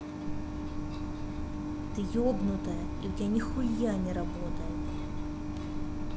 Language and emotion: Russian, angry